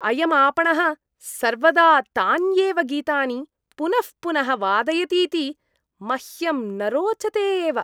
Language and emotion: Sanskrit, disgusted